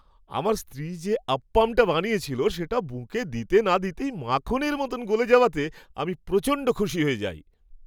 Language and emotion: Bengali, happy